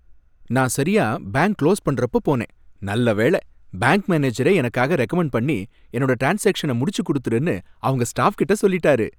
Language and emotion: Tamil, happy